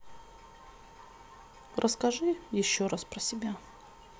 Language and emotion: Russian, sad